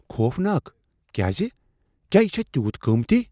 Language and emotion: Kashmiri, fearful